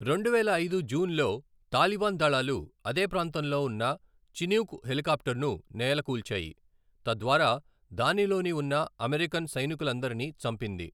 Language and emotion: Telugu, neutral